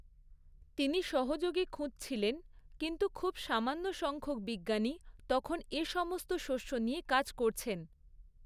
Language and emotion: Bengali, neutral